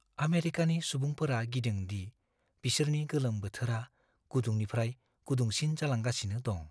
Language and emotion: Bodo, fearful